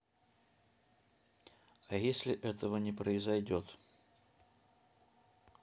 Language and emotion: Russian, neutral